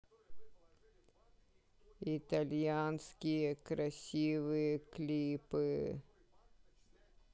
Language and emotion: Russian, sad